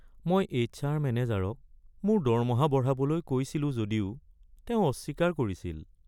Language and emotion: Assamese, sad